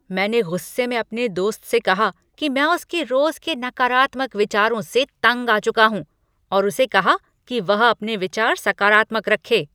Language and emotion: Hindi, angry